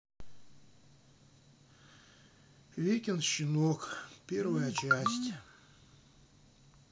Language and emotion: Russian, sad